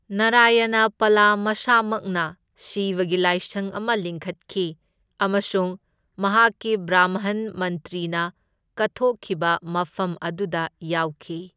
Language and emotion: Manipuri, neutral